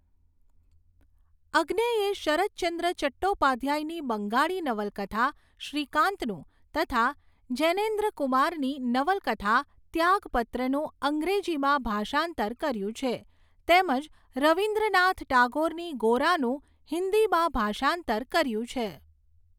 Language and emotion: Gujarati, neutral